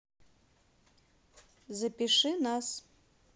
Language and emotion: Russian, neutral